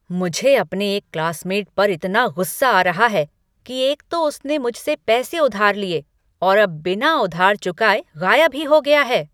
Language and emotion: Hindi, angry